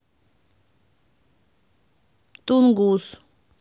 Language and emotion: Russian, neutral